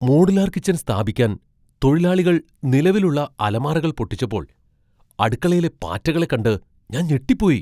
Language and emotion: Malayalam, surprised